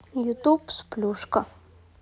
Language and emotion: Russian, neutral